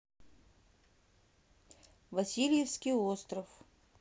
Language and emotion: Russian, neutral